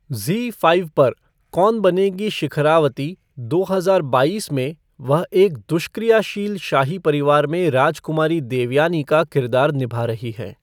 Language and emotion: Hindi, neutral